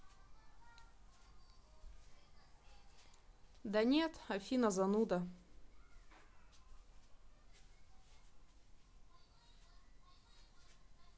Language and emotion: Russian, sad